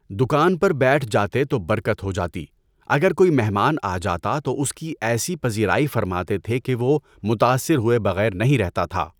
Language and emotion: Urdu, neutral